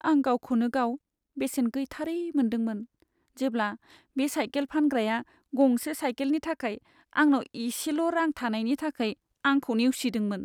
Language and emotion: Bodo, sad